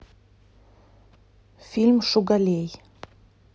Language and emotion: Russian, neutral